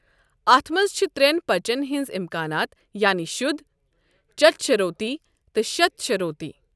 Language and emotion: Kashmiri, neutral